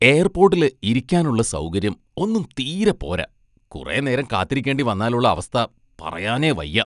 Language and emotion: Malayalam, disgusted